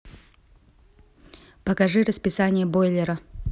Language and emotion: Russian, neutral